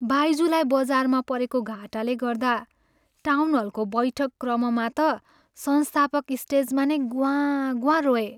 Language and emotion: Nepali, sad